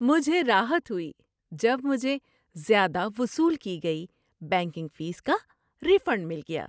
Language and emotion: Urdu, happy